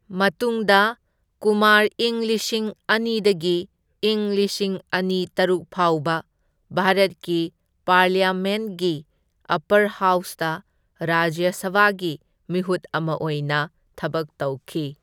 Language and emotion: Manipuri, neutral